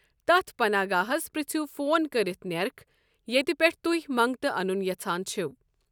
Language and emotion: Kashmiri, neutral